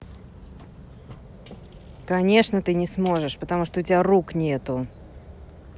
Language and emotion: Russian, angry